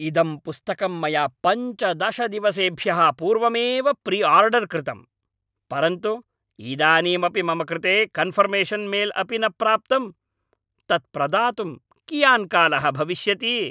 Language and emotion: Sanskrit, angry